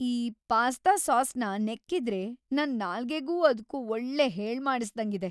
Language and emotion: Kannada, happy